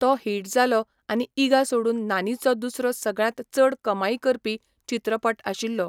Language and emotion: Goan Konkani, neutral